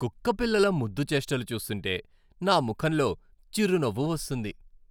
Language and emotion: Telugu, happy